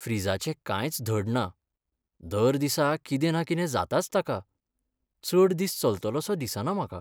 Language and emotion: Goan Konkani, sad